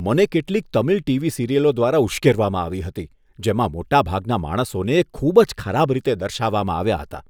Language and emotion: Gujarati, disgusted